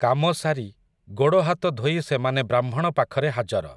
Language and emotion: Odia, neutral